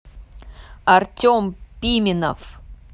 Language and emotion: Russian, neutral